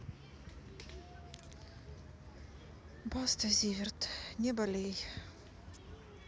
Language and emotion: Russian, sad